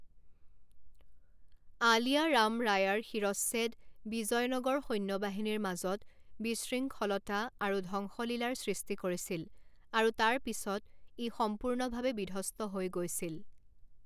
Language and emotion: Assamese, neutral